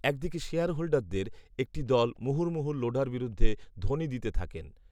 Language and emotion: Bengali, neutral